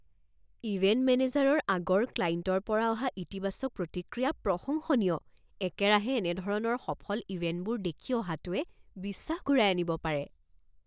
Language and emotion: Assamese, surprised